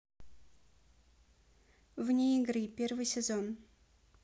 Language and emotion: Russian, neutral